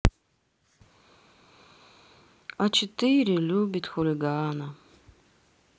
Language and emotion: Russian, sad